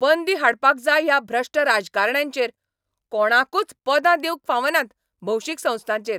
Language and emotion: Goan Konkani, angry